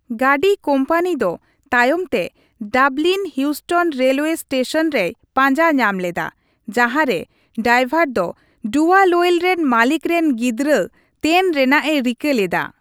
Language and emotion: Santali, neutral